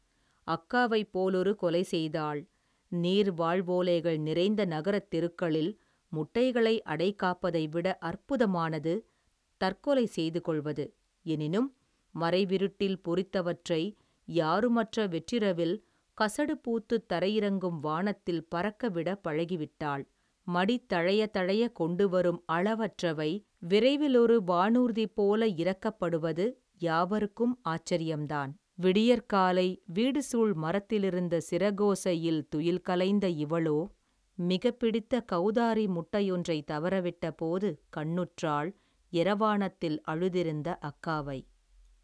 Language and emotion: Tamil, neutral